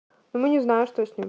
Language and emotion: Russian, neutral